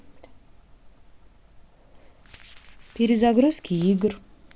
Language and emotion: Russian, neutral